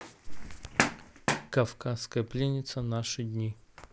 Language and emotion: Russian, neutral